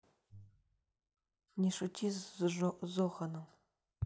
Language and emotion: Russian, neutral